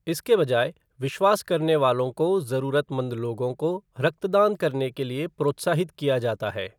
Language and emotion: Hindi, neutral